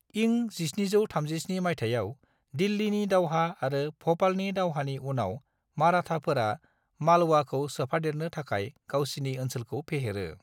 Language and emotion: Bodo, neutral